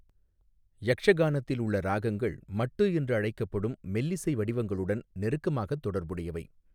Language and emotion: Tamil, neutral